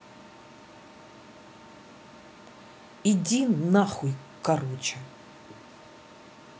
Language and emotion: Russian, angry